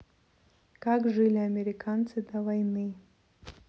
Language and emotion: Russian, neutral